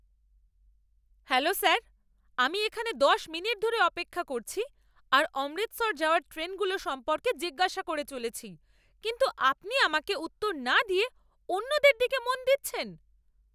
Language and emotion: Bengali, angry